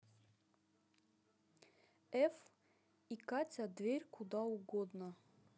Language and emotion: Russian, neutral